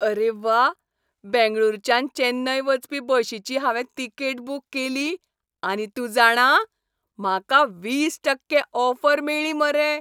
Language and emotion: Goan Konkani, happy